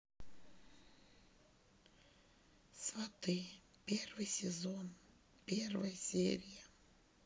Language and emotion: Russian, sad